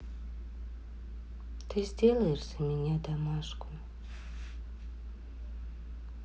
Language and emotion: Russian, sad